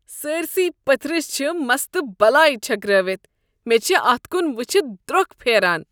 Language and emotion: Kashmiri, disgusted